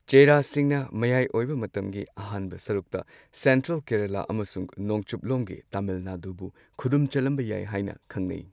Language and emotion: Manipuri, neutral